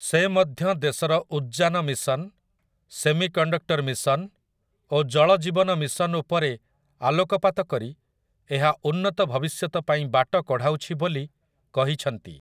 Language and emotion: Odia, neutral